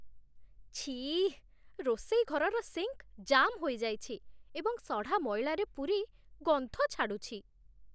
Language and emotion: Odia, disgusted